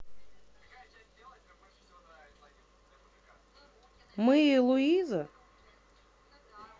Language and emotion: Russian, neutral